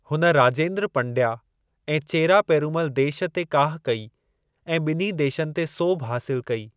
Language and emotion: Sindhi, neutral